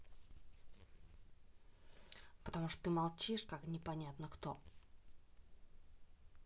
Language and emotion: Russian, neutral